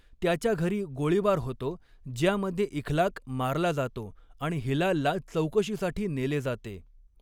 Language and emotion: Marathi, neutral